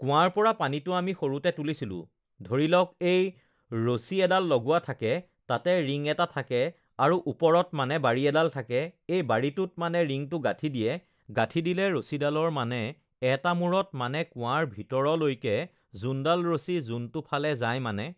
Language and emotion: Assamese, neutral